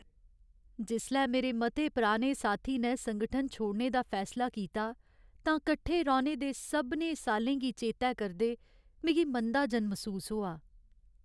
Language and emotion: Dogri, sad